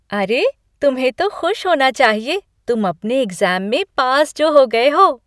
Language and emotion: Hindi, happy